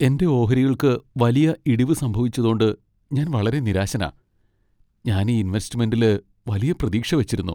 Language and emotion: Malayalam, sad